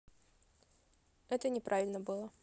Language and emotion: Russian, neutral